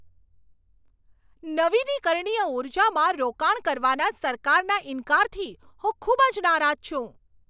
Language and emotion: Gujarati, angry